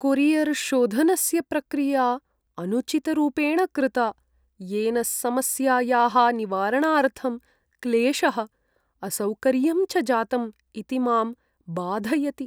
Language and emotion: Sanskrit, sad